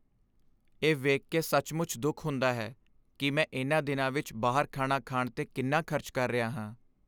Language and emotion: Punjabi, sad